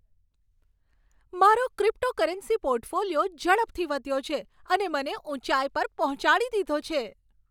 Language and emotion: Gujarati, happy